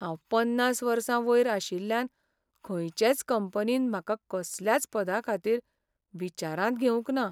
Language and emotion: Goan Konkani, sad